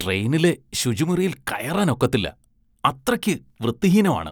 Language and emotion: Malayalam, disgusted